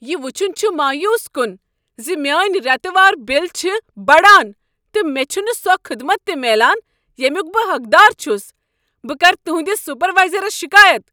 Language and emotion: Kashmiri, angry